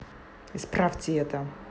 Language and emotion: Russian, angry